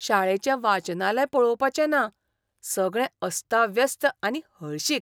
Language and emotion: Goan Konkani, disgusted